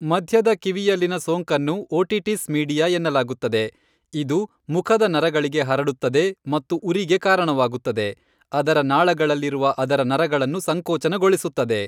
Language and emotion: Kannada, neutral